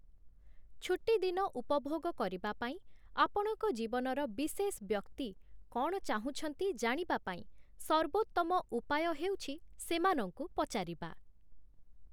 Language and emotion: Odia, neutral